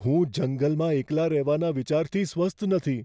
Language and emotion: Gujarati, fearful